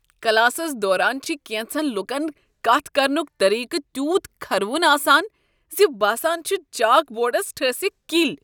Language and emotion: Kashmiri, disgusted